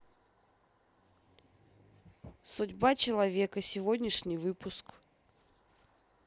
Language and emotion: Russian, neutral